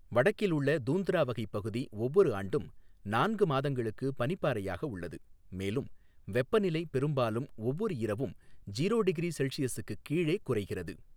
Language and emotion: Tamil, neutral